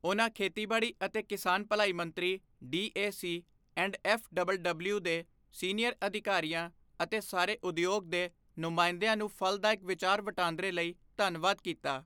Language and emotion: Punjabi, neutral